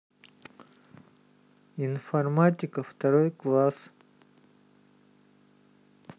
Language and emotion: Russian, neutral